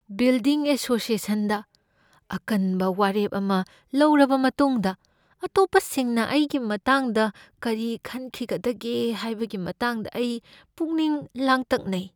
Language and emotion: Manipuri, fearful